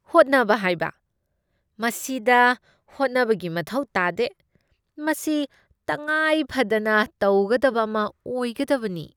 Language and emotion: Manipuri, disgusted